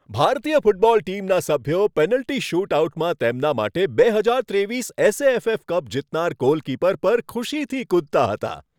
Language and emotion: Gujarati, happy